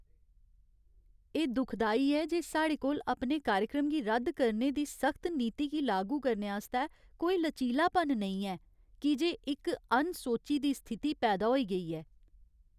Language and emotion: Dogri, sad